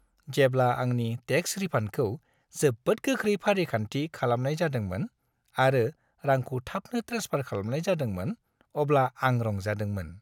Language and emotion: Bodo, happy